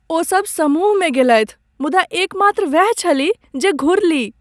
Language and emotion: Maithili, sad